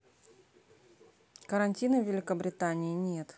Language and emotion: Russian, neutral